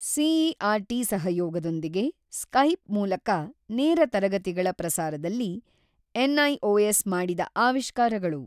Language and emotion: Kannada, neutral